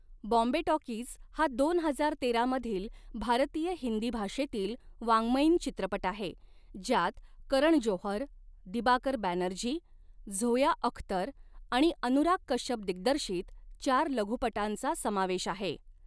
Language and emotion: Marathi, neutral